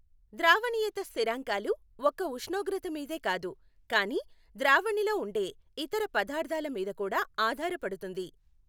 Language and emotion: Telugu, neutral